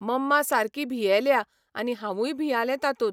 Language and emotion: Goan Konkani, neutral